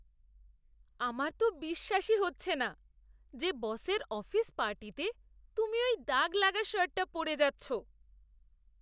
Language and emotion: Bengali, disgusted